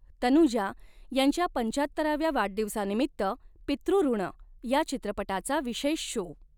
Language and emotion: Marathi, neutral